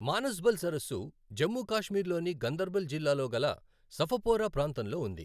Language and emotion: Telugu, neutral